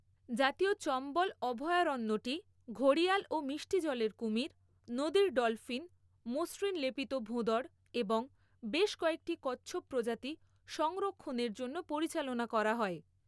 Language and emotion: Bengali, neutral